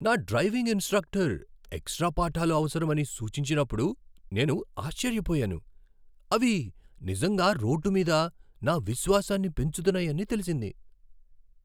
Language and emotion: Telugu, surprised